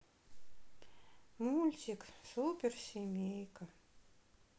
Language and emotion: Russian, sad